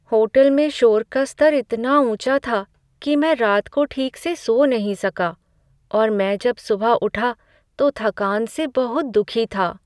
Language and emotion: Hindi, sad